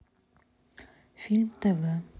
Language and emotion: Russian, neutral